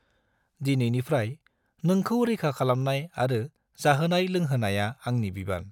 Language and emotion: Bodo, neutral